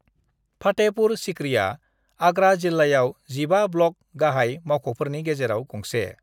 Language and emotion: Bodo, neutral